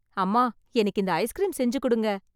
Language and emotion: Tamil, happy